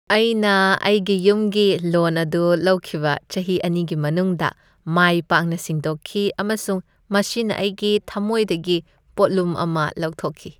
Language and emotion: Manipuri, happy